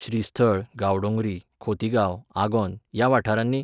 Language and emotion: Goan Konkani, neutral